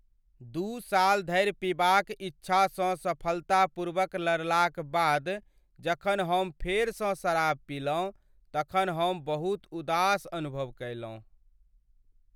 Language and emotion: Maithili, sad